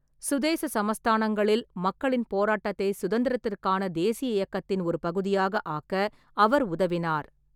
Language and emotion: Tamil, neutral